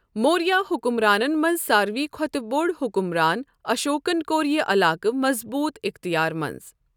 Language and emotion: Kashmiri, neutral